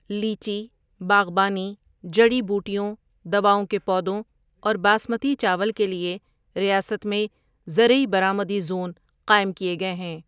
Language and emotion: Urdu, neutral